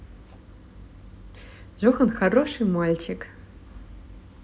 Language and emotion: Russian, positive